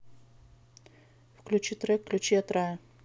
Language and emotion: Russian, neutral